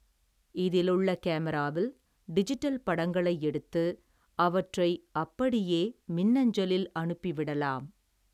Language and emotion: Tamil, neutral